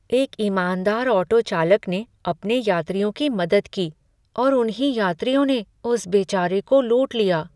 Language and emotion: Hindi, sad